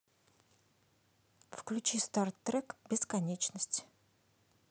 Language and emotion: Russian, neutral